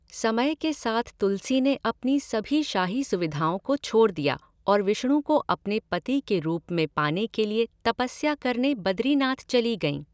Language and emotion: Hindi, neutral